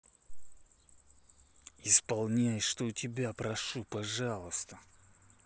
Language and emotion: Russian, angry